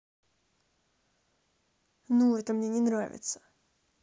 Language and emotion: Russian, angry